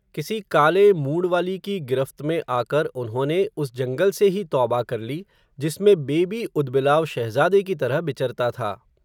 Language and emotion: Hindi, neutral